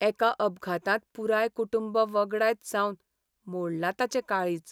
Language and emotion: Goan Konkani, sad